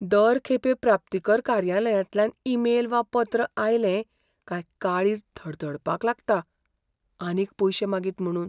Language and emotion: Goan Konkani, fearful